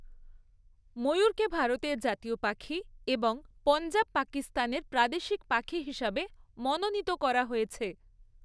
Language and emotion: Bengali, neutral